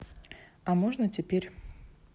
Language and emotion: Russian, neutral